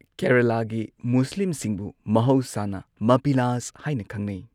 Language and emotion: Manipuri, neutral